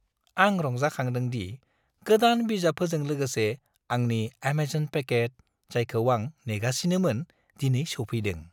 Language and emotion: Bodo, happy